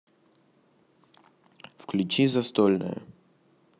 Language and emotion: Russian, neutral